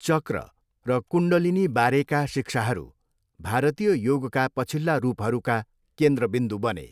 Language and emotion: Nepali, neutral